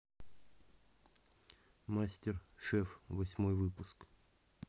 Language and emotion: Russian, neutral